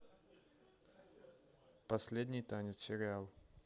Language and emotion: Russian, neutral